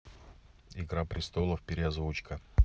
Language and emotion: Russian, neutral